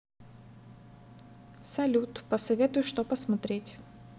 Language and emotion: Russian, neutral